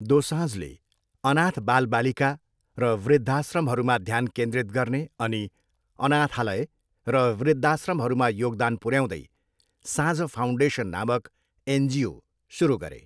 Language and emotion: Nepali, neutral